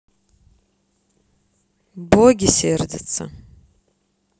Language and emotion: Russian, neutral